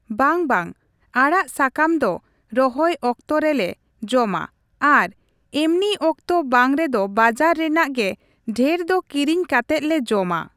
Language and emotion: Santali, neutral